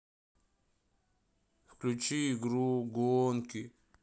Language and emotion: Russian, sad